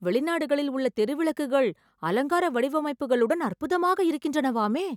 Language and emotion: Tamil, surprised